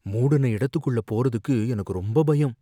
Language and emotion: Tamil, fearful